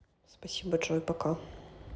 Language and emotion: Russian, neutral